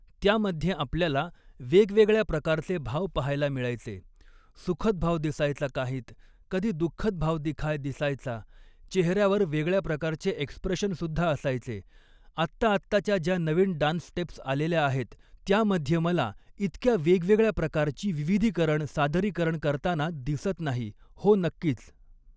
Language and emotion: Marathi, neutral